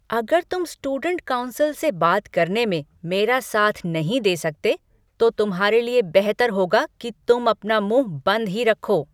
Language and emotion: Hindi, angry